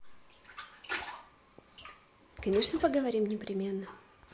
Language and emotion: Russian, positive